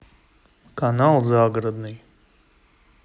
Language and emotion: Russian, neutral